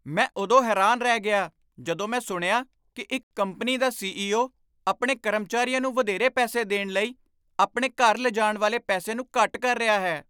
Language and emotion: Punjabi, surprised